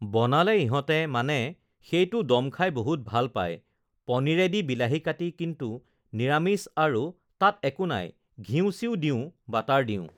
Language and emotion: Assamese, neutral